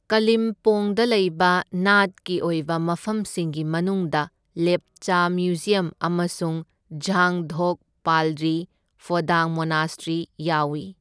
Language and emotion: Manipuri, neutral